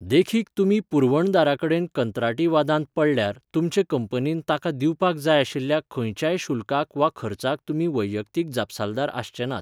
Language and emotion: Goan Konkani, neutral